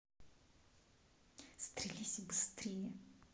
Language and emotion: Russian, neutral